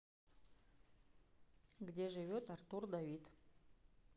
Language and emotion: Russian, neutral